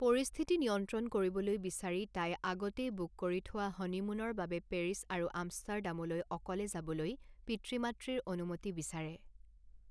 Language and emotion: Assamese, neutral